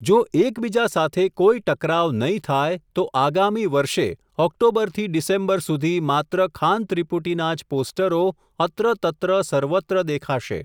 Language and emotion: Gujarati, neutral